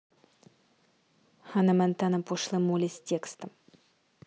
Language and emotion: Russian, neutral